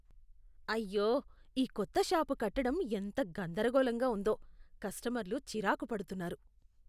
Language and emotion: Telugu, disgusted